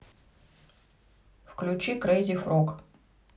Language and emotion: Russian, neutral